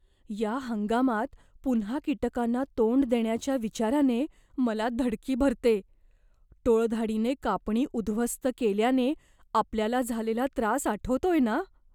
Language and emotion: Marathi, fearful